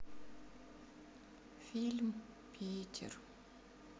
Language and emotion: Russian, sad